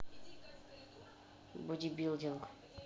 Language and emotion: Russian, neutral